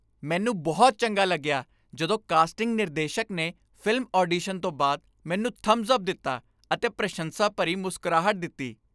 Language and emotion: Punjabi, happy